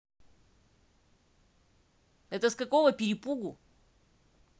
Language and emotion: Russian, angry